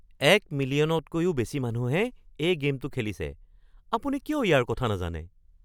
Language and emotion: Assamese, surprised